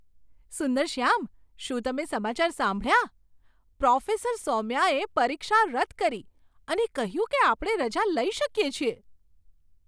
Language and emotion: Gujarati, surprised